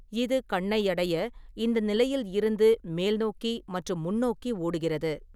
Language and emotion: Tamil, neutral